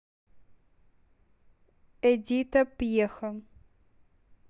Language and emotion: Russian, neutral